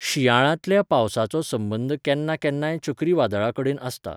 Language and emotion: Goan Konkani, neutral